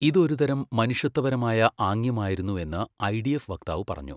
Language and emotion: Malayalam, neutral